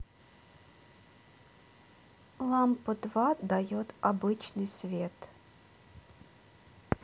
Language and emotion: Russian, neutral